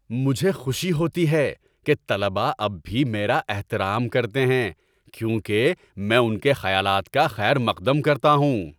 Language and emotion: Urdu, happy